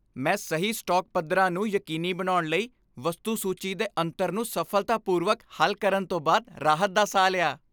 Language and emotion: Punjabi, happy